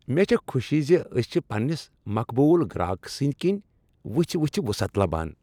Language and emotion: Kashmiri, happy